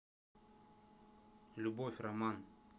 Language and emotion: Russian, neutral